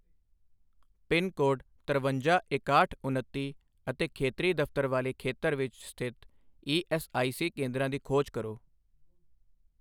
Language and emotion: Punjabi, neutral